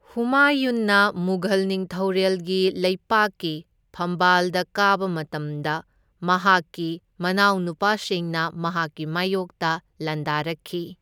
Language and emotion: Manipuri, neutral